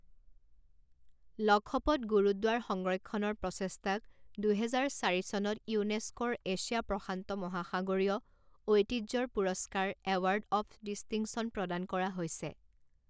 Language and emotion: Assamese, neutral